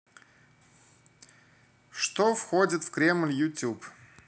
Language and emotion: Russian, neutral